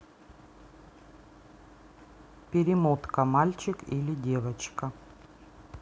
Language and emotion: Russian, neutral